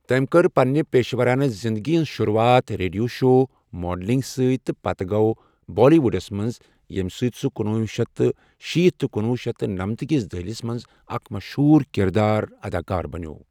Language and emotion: Kashmiri, neutral